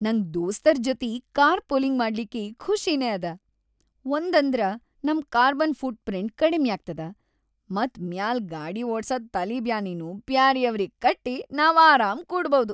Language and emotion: Kannada, happy